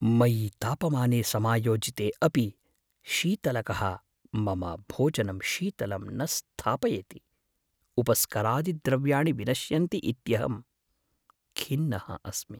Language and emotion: Sanskrit, fearful